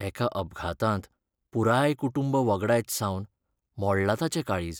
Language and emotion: Goan Konkani, sad